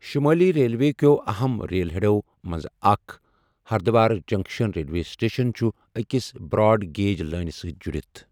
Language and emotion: Kashmiri, neutral